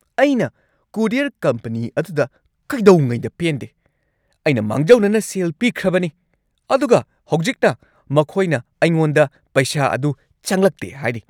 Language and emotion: Manipuri, angry